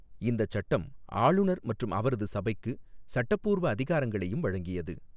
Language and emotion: Tamil, neutral